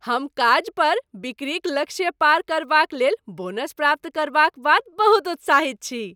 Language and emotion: Maithili, happy